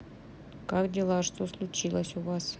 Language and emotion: Russian, neutral